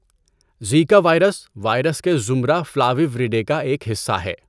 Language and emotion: Urdu, neutral